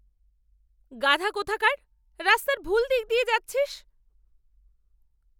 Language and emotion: Bengali, angry